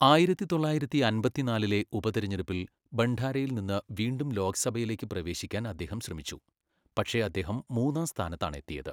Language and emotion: Malayalam, neutral